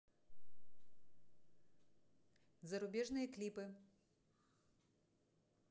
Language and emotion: Russian, neutral